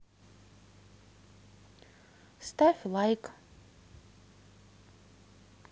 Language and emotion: Russian, neutral